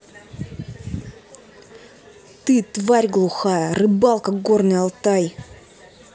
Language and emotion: Russian, angry